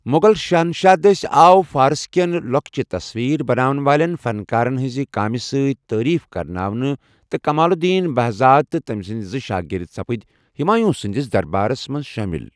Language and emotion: Kashmiri, neutral